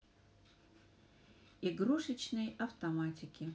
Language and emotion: Russian, neutral